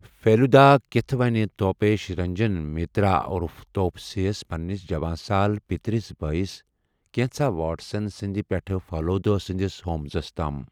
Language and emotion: Kashmiri, neutral